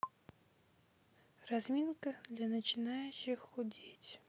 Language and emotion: Russian, neutral